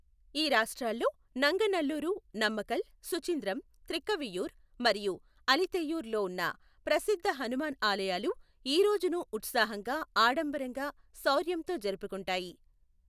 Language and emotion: Telugu, neutral